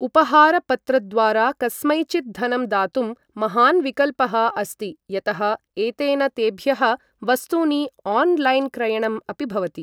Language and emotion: Sanskrit, neutral